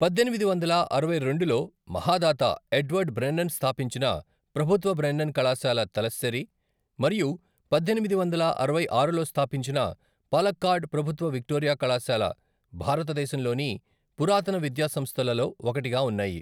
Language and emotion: Telugu, neutral